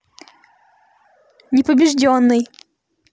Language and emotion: Russian, neutral